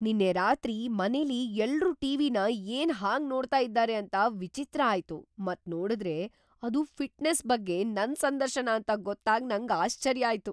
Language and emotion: Kannada, surprised